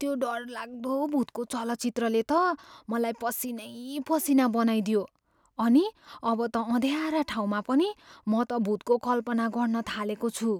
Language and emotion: Nepali, fearful